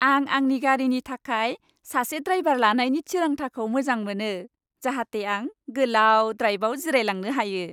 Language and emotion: Bodo, happy